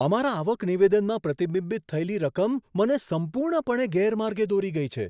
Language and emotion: Gujarati, surprised